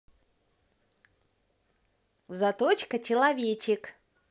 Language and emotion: Russian, positive